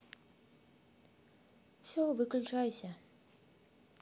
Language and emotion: Russian, neutral